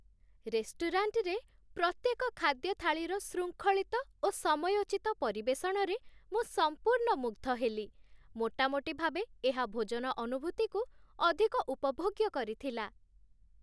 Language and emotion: Odia, happy